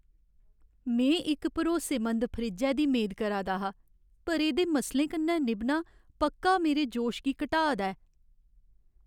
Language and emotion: Dogri, sad